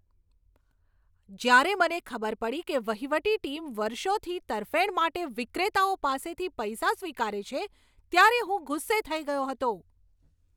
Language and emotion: Gujarati, angry